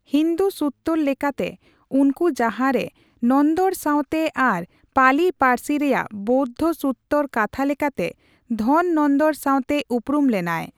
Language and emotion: Santali, neutral